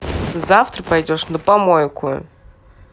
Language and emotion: Russian, angry